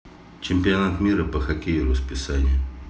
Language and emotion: Russian, neutral